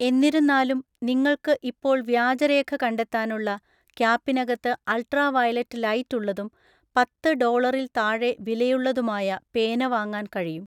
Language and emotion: Malayalam, neutral